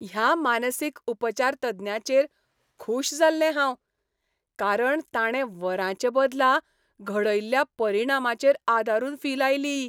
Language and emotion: Goan Konkani, happy